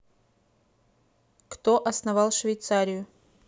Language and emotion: Russian, neutral